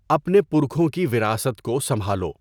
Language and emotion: Urdu, neutral